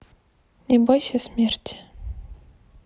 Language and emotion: Russian, neutral